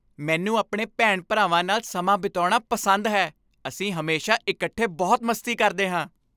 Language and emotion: Punjabi, happy